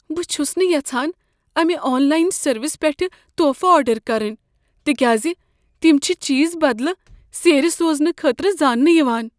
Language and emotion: Kashmiri, fearful